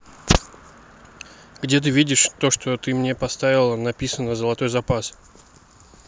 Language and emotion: Russian, neutral